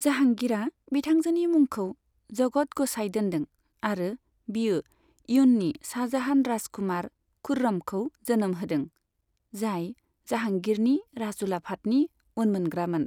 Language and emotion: Bodo, neutral